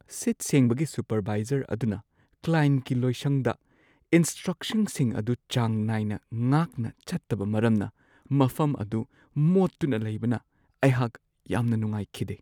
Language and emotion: Manipuri, sad